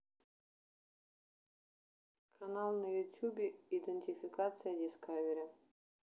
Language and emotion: Russian, neutral